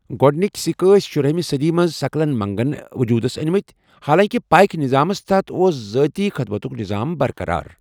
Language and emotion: Kashmiri, neutral